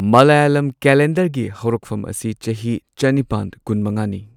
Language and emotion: Manipuri, neutral